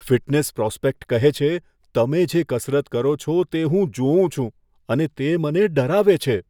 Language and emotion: Gujarati, fearful